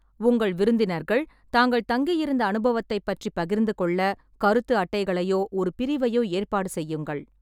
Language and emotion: Tamil, neutral